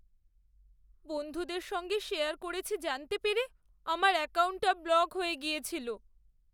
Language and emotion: Bengali, sad